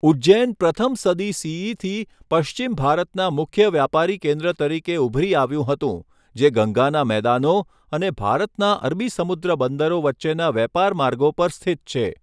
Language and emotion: Gujarati, neutral